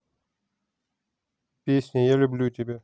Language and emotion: Russian, neutral